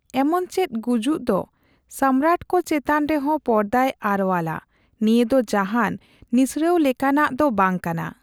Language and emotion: Santali, neutral